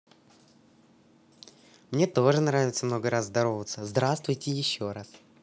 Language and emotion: Russian, positive